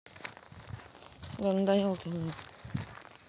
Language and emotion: Russian, neutral